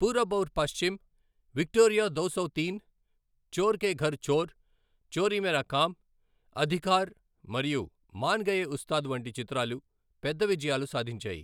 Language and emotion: Telugu, neutral